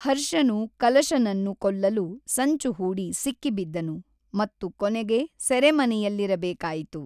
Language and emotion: Kannada, neutral